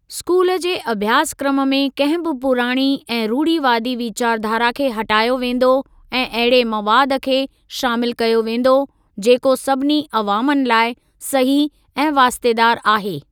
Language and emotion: Sindhi, neutral